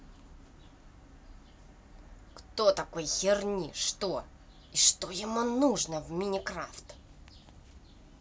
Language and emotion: Russian, angry